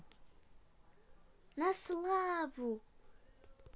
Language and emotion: Russian, positive